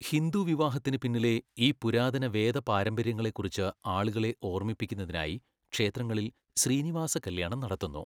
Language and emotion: Malayalam, neutral